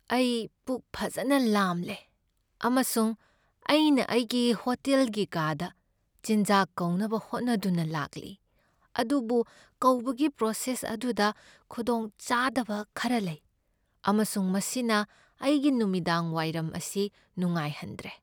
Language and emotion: Manipuri, sad